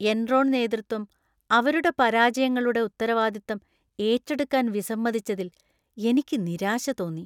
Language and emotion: Malayalam, disgusted